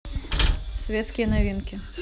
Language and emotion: Russian, neutral